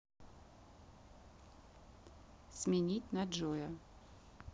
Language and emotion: Russian, neutral